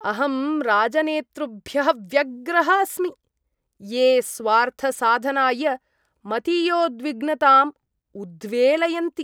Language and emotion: Sanskrit, disgusted